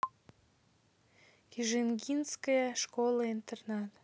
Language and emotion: Russian, neutral